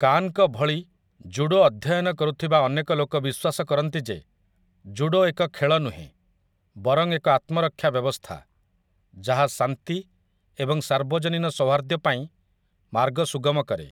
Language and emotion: Odia, neutral